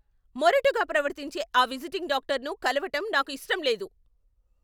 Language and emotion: Telugu, angry